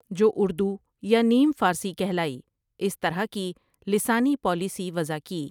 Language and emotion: Urdu, neutral